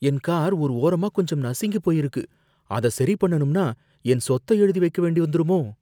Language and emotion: Tamil, fearful